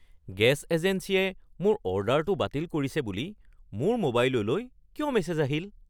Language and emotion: Assamese, surprised